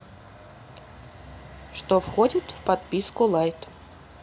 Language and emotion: Russian, neutral